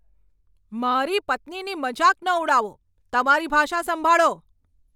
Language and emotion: Gujarati, angry